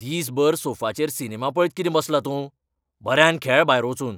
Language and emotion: Goan Konkani, angry